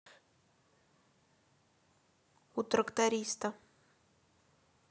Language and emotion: Russian, neutral